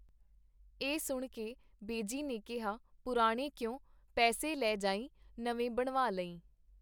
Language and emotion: Punjabi, neutral